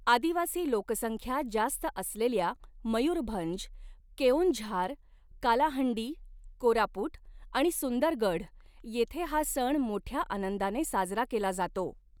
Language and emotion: Marathi, neutral